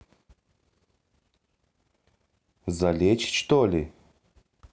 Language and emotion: Russian, neutral